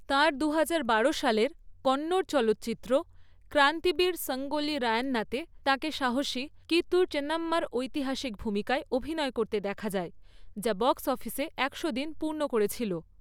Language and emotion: Bengali, neutral